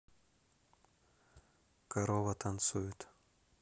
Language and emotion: Russian, neutral